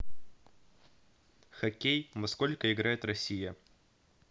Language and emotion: Russian, neutral